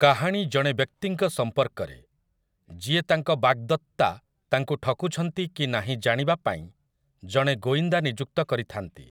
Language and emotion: Odia, neutral